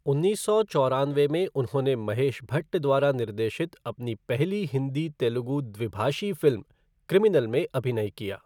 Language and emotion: Hindi, neutral